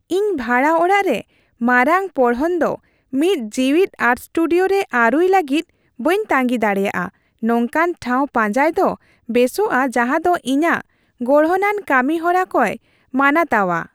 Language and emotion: Santali, happy